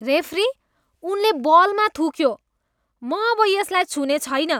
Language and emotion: Nepali, disgusted